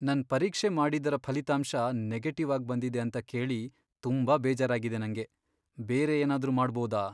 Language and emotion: Kannada, sad